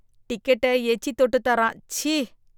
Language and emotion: Tamil, disgusted